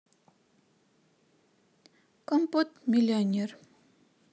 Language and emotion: Russian, neutral